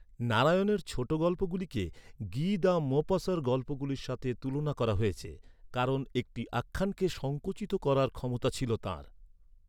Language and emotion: Bengali, neutral